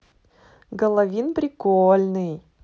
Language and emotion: Russian, positive